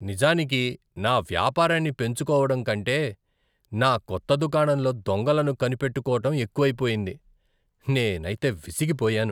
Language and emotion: Telugu, disgusted